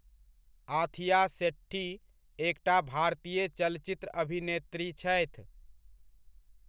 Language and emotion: Maithili, neutral